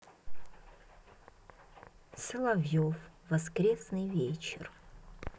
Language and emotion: Russian, neutral